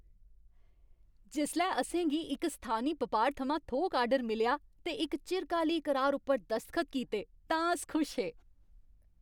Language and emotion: Dogri, happy